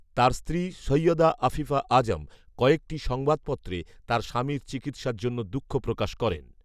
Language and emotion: Bengali, neutral